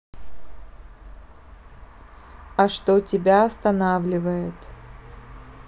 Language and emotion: Russian, neutral